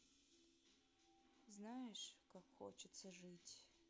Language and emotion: Russian, sad